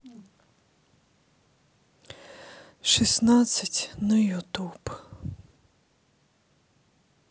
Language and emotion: Russian, sad